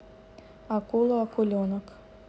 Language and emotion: Russian, neutral